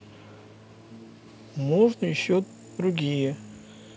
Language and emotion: Russian, neutral